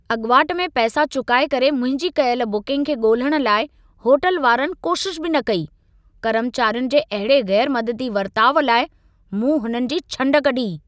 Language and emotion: Sindhi, angry